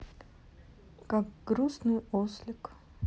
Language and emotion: Russian, sad